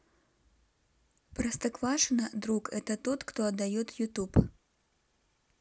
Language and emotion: Russian, neutral